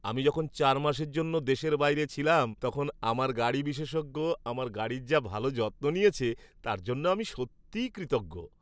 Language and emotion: Bengali, happy